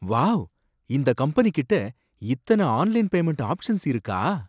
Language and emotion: Tamil, surprised